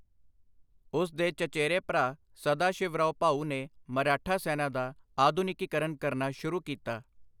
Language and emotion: Punjabi, neutral